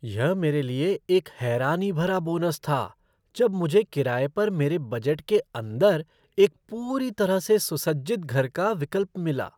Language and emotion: Hindi, surprised